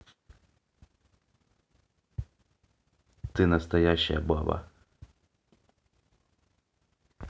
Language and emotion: Russian, neutral